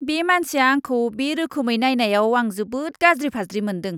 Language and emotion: Bodo, disgusted